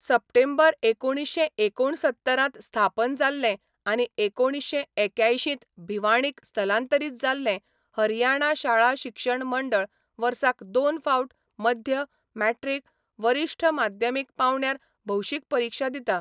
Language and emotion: Goan Konkani, neutral